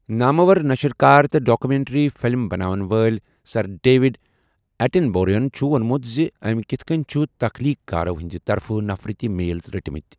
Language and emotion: Kashmiri, neutral